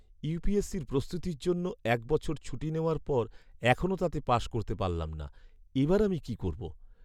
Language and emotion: Bengali, sad